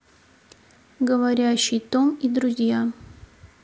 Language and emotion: Russian, neutral